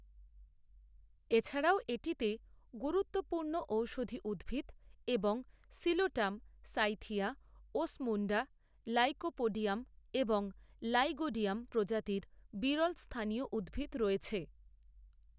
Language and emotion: Bengali, neutral